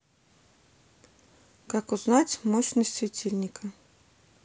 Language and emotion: Russian, neutral